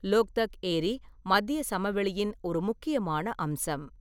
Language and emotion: Tamil, neutral